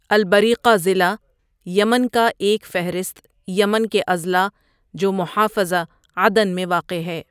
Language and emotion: Urdu, neutral